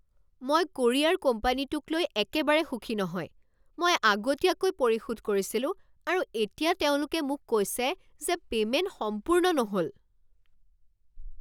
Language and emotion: Assamese, angry